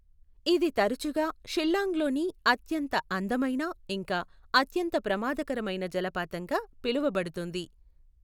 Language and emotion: Telugu, neutral